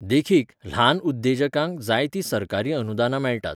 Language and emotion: Goan Konkani, neutral